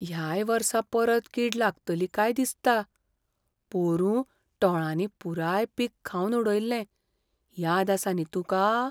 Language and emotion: Goan Konkani, fearful